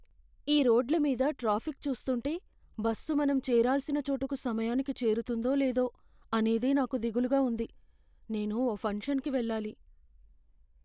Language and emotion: Telugu, fearful